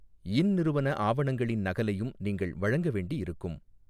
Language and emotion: Tamil, neutral